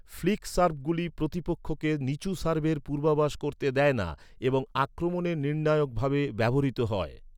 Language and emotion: Bengali, neutral